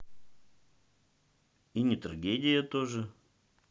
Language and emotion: Russian, neutral